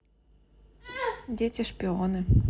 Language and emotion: Russian, neutral